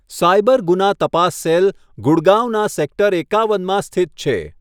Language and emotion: Gujarati, neutral